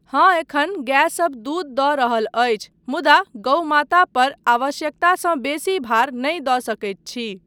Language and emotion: Maithili, neutral